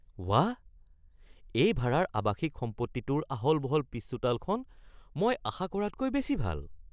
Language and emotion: Assamese, surprised